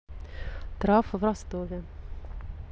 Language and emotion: Russian, neutral